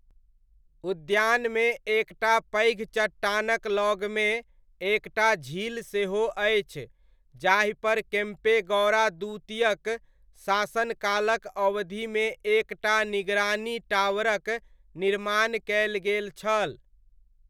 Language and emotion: Maithili, neutral